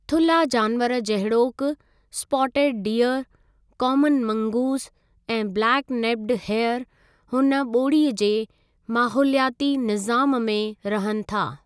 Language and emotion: Sindhi, neutral